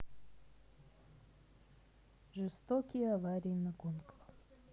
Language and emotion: Russian, sad